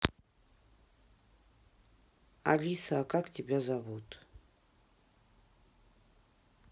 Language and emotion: Russian, neutral